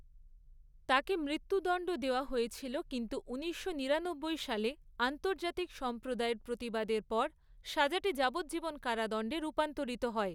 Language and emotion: Bengali, neutral